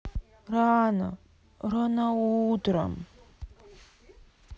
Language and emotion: Russian, sad